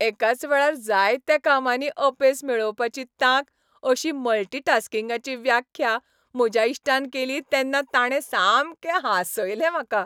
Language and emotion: Goan Konkani, happy